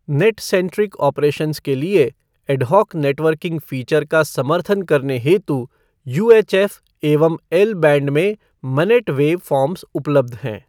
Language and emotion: Hindi, neutral